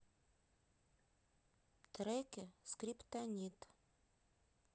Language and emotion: Russian, neutral